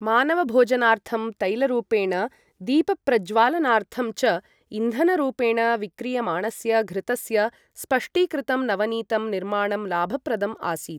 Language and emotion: Sanskrit, neutral